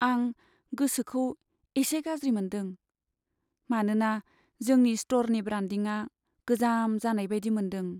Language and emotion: Bodo, sad